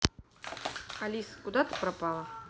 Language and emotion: Russian, neutral